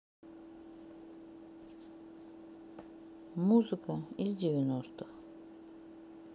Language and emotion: Russian, neutral